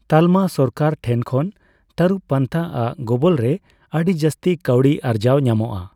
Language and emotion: Santali, neutral